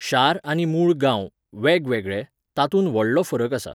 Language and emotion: Goan Konkani, neutral